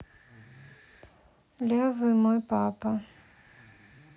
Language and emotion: Russian, sad